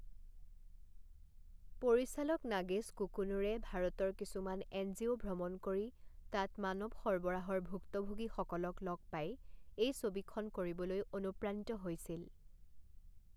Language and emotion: Assamese, neutral